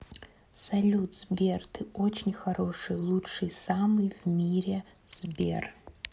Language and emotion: Russian, neutral